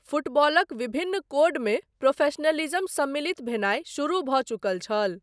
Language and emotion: Maithili, neutral